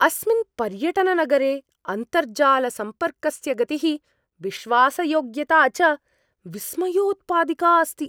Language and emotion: Sanskrit, surprised